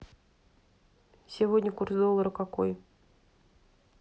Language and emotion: Russian, neutral